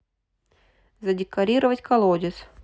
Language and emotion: Russian, neutral